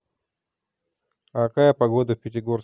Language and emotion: Russian, neutral